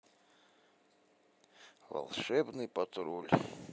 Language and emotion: Russian, neutral